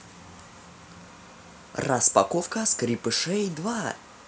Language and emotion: Russian, positive